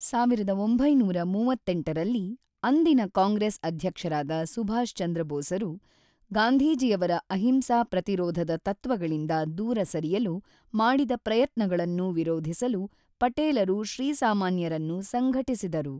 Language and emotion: Kannada, neutral